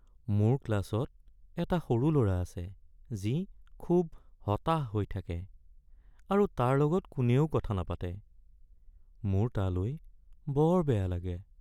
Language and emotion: Assamese, sad